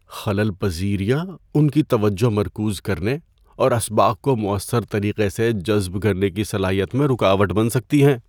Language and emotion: Urdu, fearful